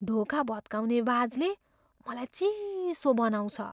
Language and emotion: Nepali, fearful